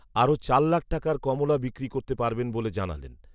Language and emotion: Bengali, neutral